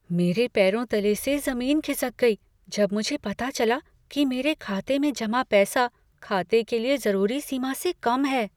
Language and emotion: Hindi, fearful